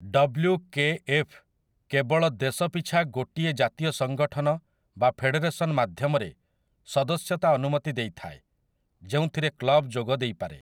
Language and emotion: Odia, neutral